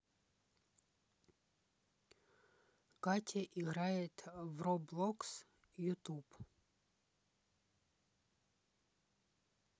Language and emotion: Russian, neutral